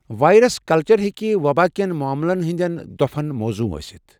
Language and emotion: Kashmiri, neutral